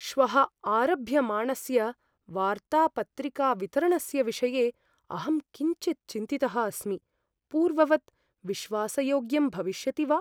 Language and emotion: Sanskrit, fearful